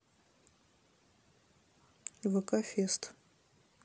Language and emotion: Russian, neutral